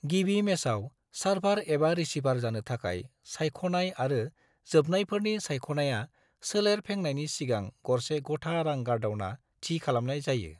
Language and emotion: Bodo, neutral